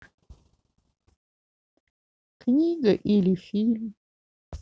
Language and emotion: Russian, sad